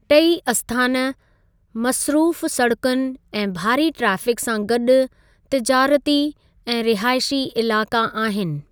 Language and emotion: Sindhi, neutral